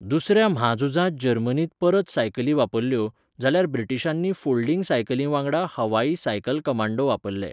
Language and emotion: Goan Konkani, neutral